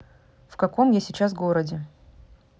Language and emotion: Russian, neutral